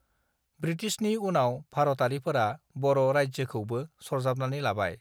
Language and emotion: Bodo, neutral